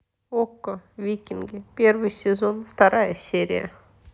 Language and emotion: Russian, neutral